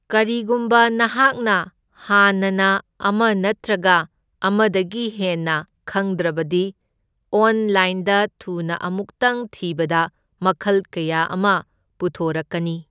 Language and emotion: Manipuri, neutral